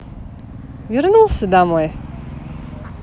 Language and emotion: Russian, positive